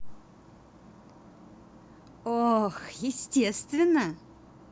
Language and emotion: Russian, positive